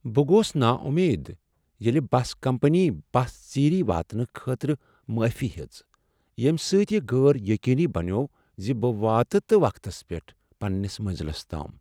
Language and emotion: Kashmiri, sad